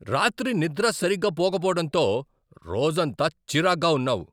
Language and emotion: Telugu, angry